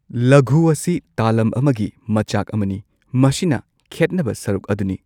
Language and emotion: Manipuri, neutral